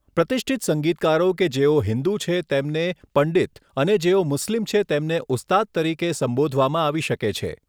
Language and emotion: Gujarati, neutral